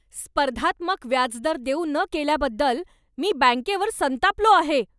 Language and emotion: Marathi, angry